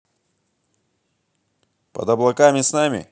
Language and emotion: Russian, positive